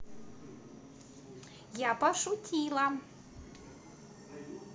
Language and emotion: Russian, positive